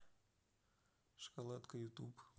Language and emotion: Russian, neutral